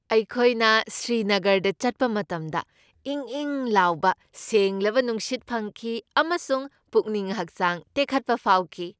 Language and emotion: Manipuri, happy